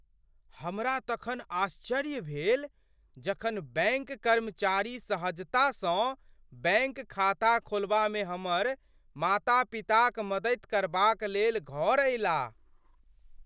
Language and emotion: Maithili, surprised